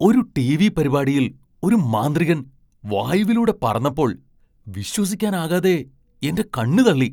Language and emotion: Malayalam, surprised